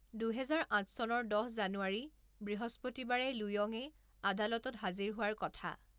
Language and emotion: Assamese, neutral